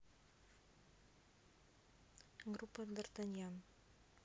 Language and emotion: Russian, neutral